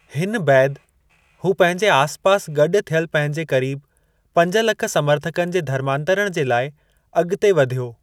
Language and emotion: Sindhi, neutral